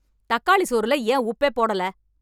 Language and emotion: Tamil, angry